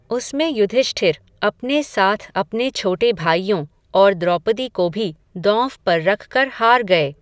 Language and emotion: Hindi, neutral